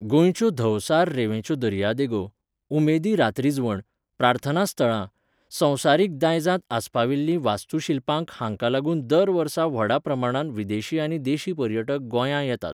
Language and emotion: Goan Konkani, neutral